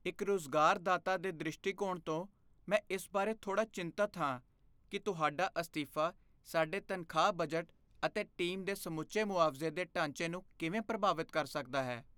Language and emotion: Punjabi, fearful